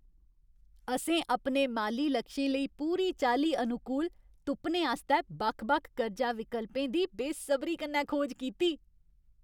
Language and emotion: Dogri, happy